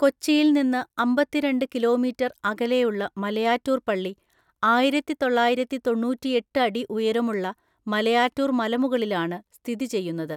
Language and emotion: Malayalam, neutral